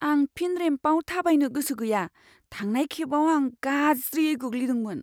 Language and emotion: Bodo, fearful